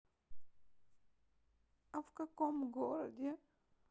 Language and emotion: Russian, sad